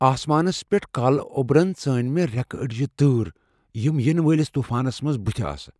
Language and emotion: Kashmiri, fearful